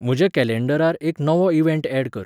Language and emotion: Goan Konkani, neutral